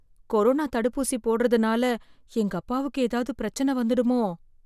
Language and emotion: Tamil, fearful